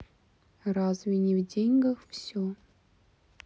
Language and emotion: Russian, sad